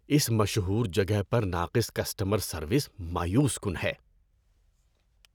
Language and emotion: Urdu, disgusted